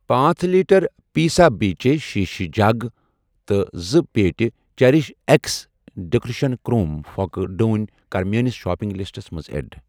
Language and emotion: Kashmiri, neutral